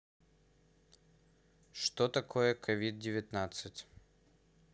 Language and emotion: Russian, neutral